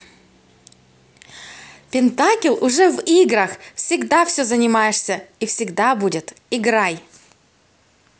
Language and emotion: Russian, positive